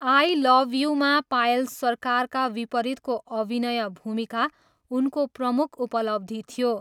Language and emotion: Nepali, neutral